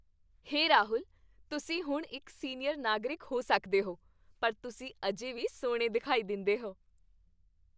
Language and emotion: Punjabi, happy